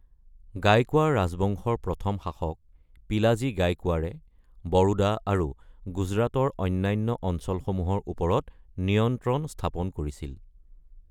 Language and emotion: Assamese, neutral